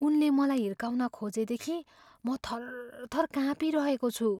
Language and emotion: Nepali, fearful